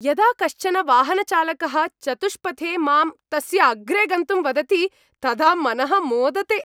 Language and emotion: Sanskrit, happy